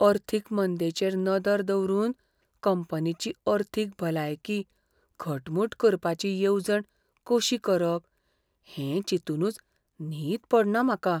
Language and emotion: Goan Konkani, fearful